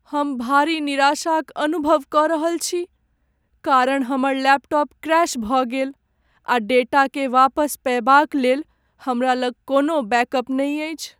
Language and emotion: Maithili, sad